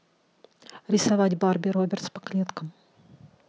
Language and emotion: Russian, neutral